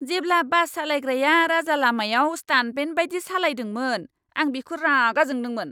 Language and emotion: Bodo, angry